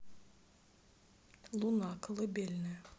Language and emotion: Russian, neutral